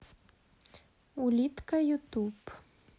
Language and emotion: Russian, neutral